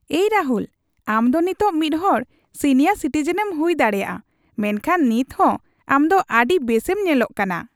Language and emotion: Santali, happy